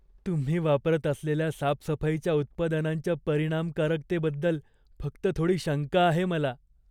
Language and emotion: Marathi, fearful